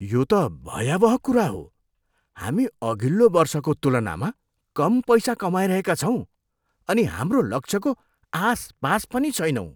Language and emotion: Nepali, disgusted